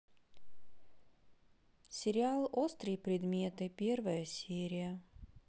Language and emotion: Russian, neutral